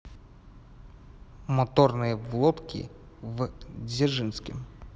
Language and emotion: Russian, neutral